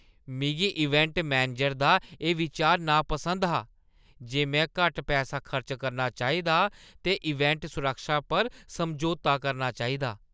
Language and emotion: Dogri, disgusted